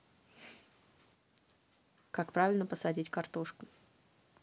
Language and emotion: Russian, neutral